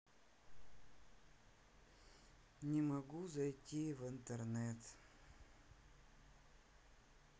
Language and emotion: Russian, sad